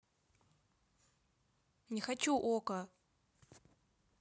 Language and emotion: Russian, angry